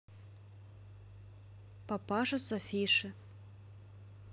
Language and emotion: Russian, neutral